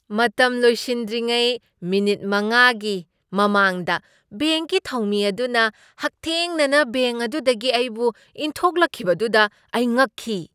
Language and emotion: Manipuri, surprised